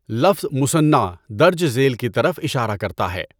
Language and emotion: Urdu, neutral